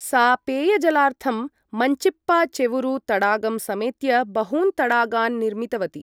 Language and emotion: Sanskrit, neutral